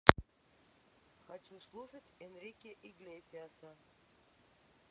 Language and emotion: Russian, neutral